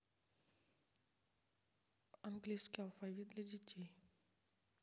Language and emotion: Russian, neutral